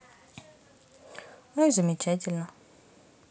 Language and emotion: Russian, neutral